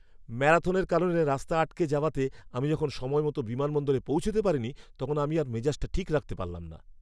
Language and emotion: Bengali, angry